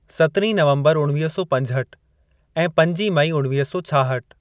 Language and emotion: Sindhi, neutral